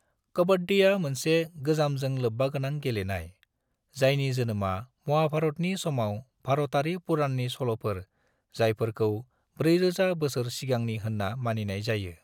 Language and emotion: Bodo, neutral